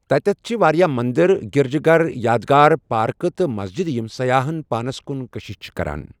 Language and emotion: Kashmiri, neutral